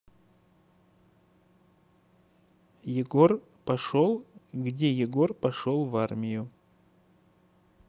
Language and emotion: Russian, neutral